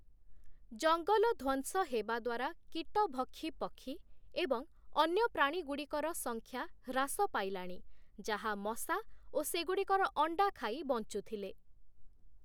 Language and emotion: Odia, neutral